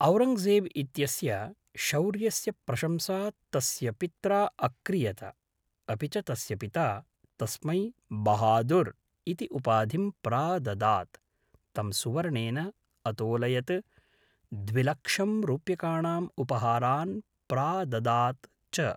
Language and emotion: Sanskrit, neutral